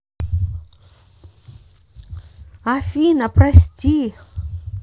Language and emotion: Russian, positive